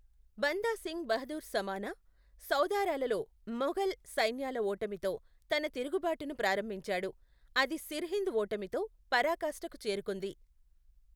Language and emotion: Telugu, neutral